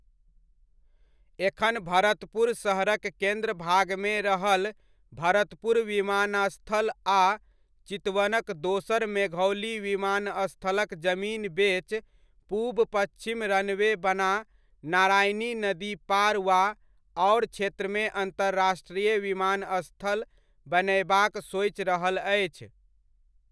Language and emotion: Maithili, neutral